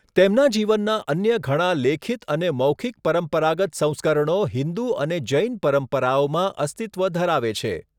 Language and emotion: Gujarati, neutral